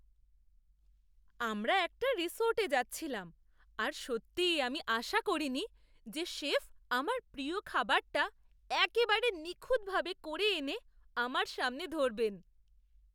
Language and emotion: Bengali, surprised